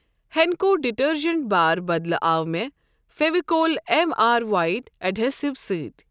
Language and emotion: Kashmiri, neutral